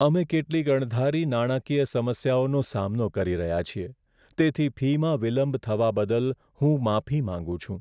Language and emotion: Gujarati, sad